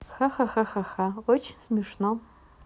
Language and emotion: Russian, neutral